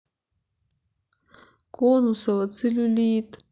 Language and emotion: Russian, sad